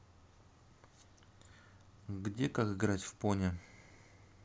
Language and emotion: Russian, neutral